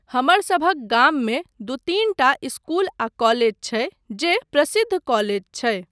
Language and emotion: Maithili, neutral